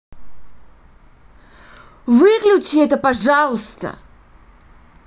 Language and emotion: Russian, angry